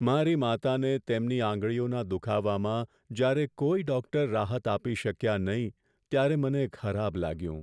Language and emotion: Gujarati, sad